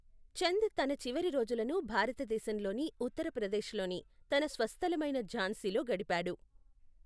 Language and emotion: Telugu, neutral